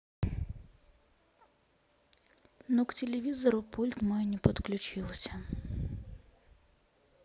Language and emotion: Russian, sad